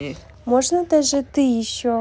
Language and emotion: Russian, neutral